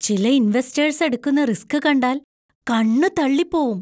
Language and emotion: Malayalam, surprised